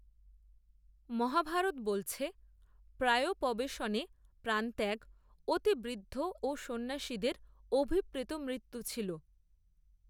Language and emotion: Bengali, neutral